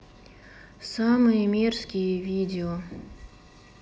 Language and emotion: Russian, sad